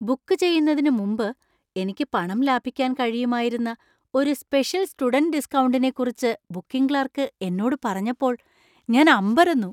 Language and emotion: Malayalam, surprised